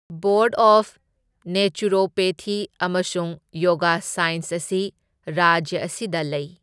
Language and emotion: Manipuri, neutral